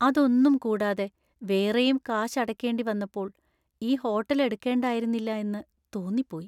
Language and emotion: Malayalam, sad